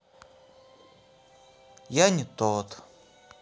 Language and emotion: Russian, sad